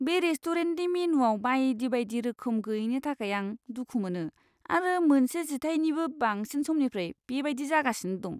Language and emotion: Bodo, disgusted